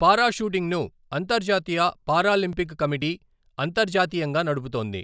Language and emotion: Telugu, neutral